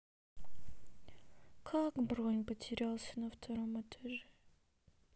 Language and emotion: Russian, sad